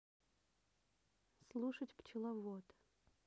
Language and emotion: Russian, neutral